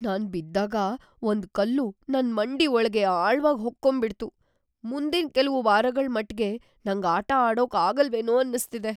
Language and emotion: Kannada, fearful